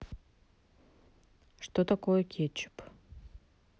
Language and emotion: Russian, neutral